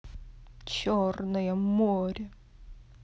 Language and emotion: Russian, angry